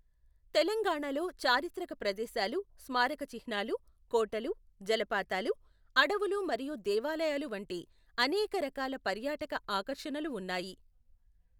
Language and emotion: Telugu, neutral